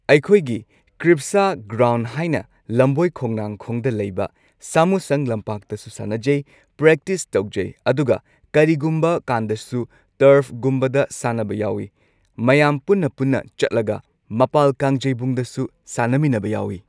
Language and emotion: Manipuri, neutral